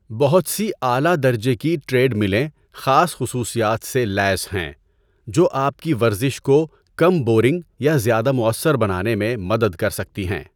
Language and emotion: Urdu, neutral